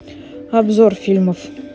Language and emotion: Russian, neutral